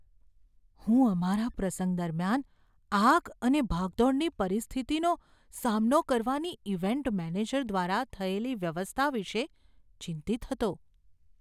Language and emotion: Gujarati, fearful